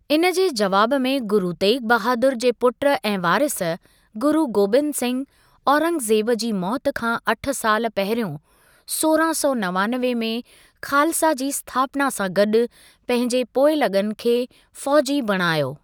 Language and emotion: Sindhi, neutral